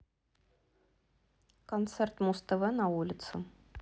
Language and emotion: Russian, neutral